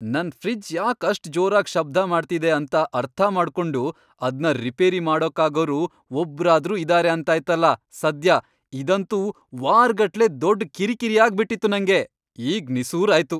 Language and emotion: Kannada, happy